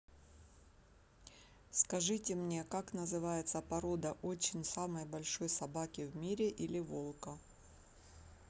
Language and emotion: Russian, neutral